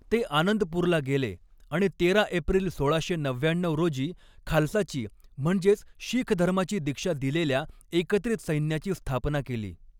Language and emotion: Marathi, neutral